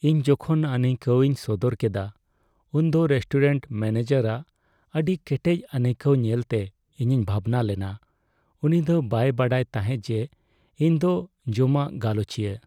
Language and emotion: Santali, sad